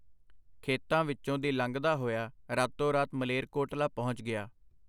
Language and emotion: Punjabi, neutral